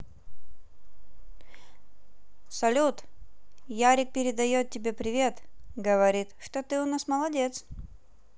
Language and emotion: Russian, positive